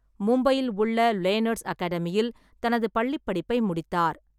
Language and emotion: Tamil, neutral